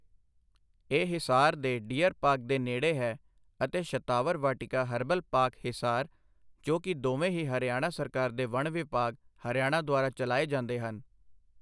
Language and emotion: Punjabi, neutral